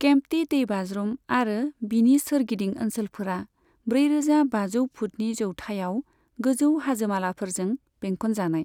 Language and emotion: Bodo, neutral